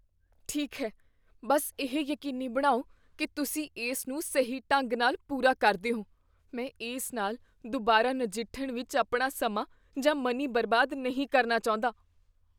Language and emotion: Punjabi, fearful